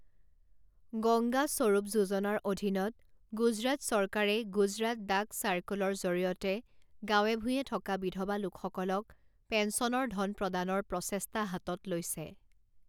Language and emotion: Assamese, neutral